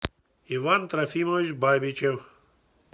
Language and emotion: Russian, neutral